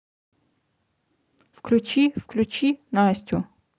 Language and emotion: Russian, neutral